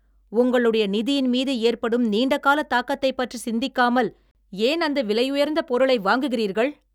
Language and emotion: Tamil, angry